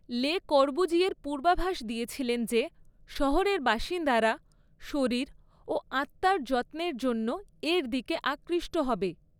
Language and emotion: Bengali, neutral